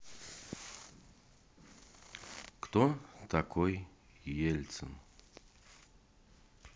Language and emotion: Russian, neutral